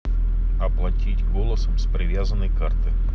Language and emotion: Russian, neutral